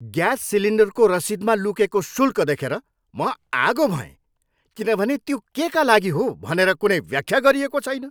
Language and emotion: Nepali, angry